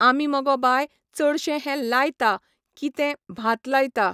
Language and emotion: Goan Konkani, neutral